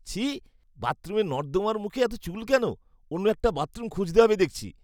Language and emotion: Bengali, disgusted